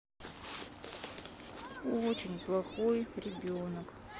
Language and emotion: Russian, sad